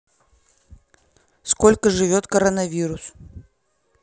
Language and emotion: Russian, neutral